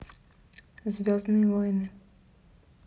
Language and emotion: Russian, neutral